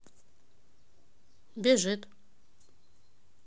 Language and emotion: Russian, neutral